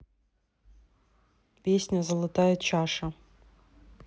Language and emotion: Russian, neutral